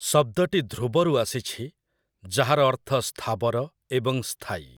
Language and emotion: Odia, neutral